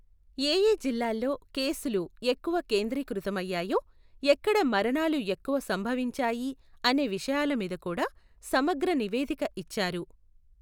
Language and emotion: Telugu, neutral